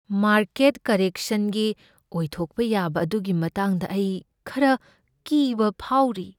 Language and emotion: Manipuri, fearful